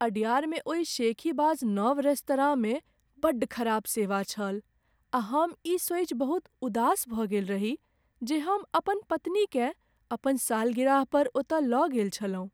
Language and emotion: Maithili, sad